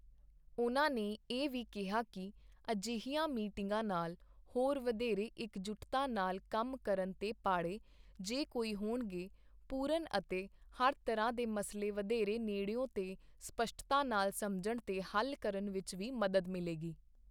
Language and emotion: Punjabi, neutral